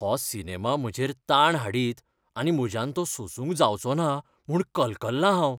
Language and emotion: Goan Konkani, fearful